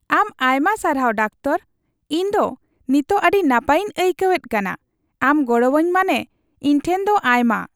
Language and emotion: Santali, happy